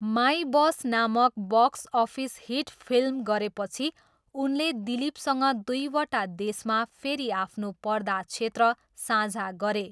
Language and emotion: Nepali, neutral